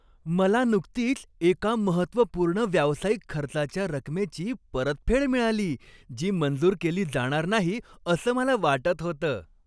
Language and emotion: Marathi, happy